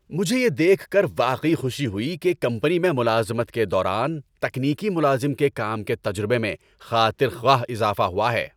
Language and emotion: Urdu, happy